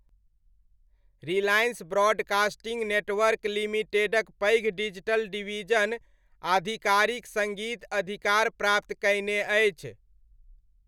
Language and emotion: Maithili, neutral